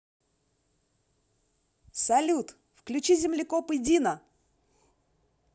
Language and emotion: Russian, positive